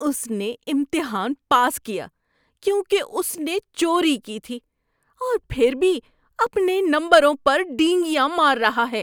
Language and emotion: Urdu, disgusted